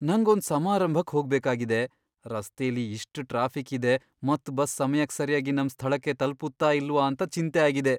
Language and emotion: Kannada, fearful